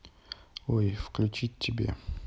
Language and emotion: Russian, neutral